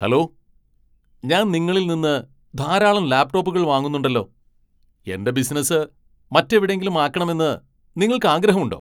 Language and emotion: Malayalam, angry